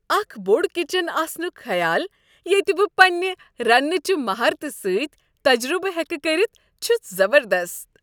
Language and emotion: Kashmiri, happy